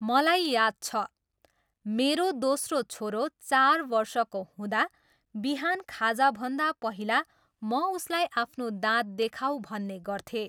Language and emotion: Nepali, neutral